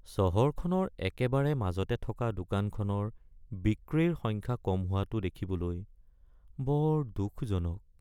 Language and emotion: Assamese, sad